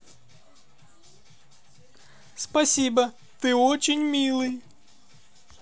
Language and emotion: Russian, positive